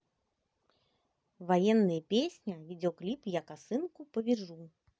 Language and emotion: Russian, positive